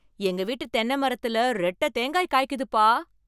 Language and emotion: Tamil, surprised